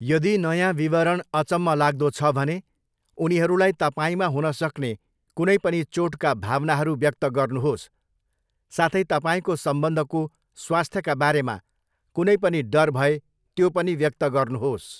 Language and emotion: Nepali, neutral